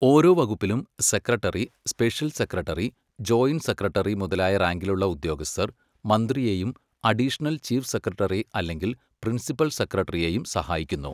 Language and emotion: Malayalam, neutral